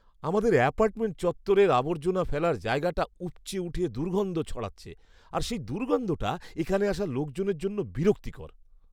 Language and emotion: Bengali, disgusted